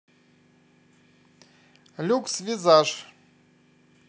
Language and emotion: Russian, neutral